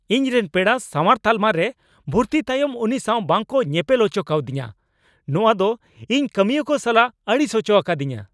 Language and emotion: Santali, angry